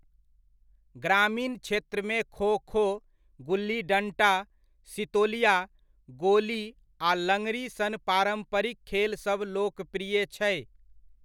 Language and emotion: Maithili, neutral